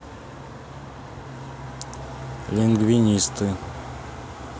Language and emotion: Russian, neutral